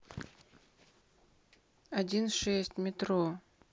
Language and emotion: Russian, neutral